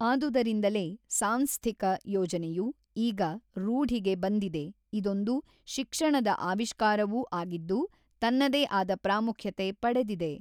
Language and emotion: Kannada, neutral